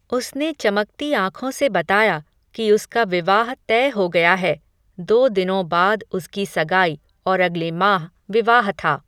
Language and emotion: Hindi, neutral